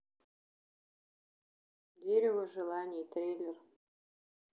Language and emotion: Russian, neutral